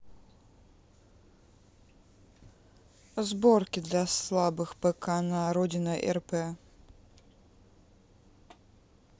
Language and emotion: Russian, neutral